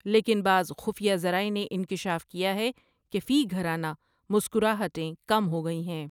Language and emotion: Urdu, neutral